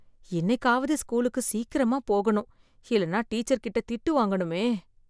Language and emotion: Tamil, fearful